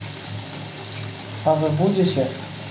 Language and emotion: Russian, neutral